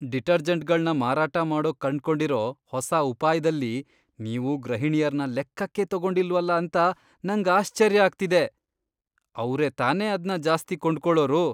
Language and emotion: Kannada, disgusted